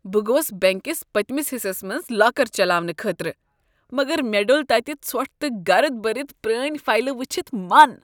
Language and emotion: Kashmiri, disgusted